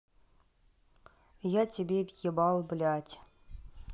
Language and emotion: Russian, neutral